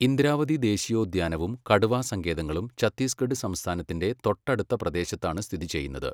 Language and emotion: Malayalam, neutral